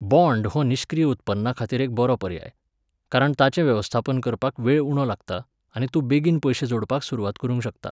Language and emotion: Goan Konkani, neutral